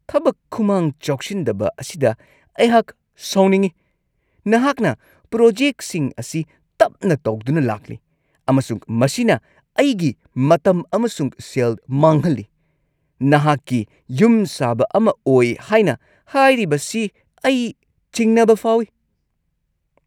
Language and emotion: Manipuri, angry